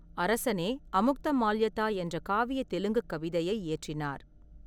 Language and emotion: Tamil, neutral